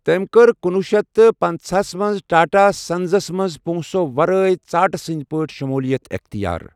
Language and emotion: Kashmiri, neutral